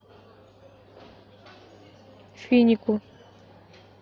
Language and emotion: Russian, neutral